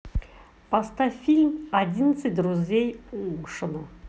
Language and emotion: Russian, neutral